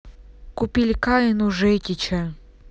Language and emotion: Russian, neutral